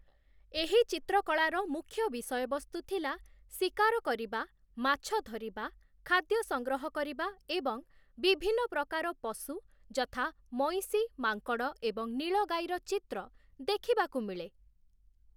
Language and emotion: Odia, neutral